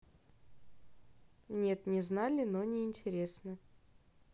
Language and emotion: Russian, neutral